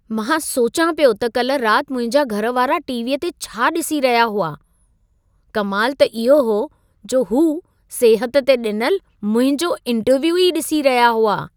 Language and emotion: Sindhi, surprised